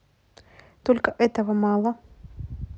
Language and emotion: Russian, neutral